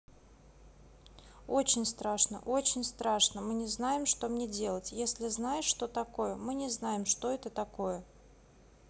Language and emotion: Russian, neutral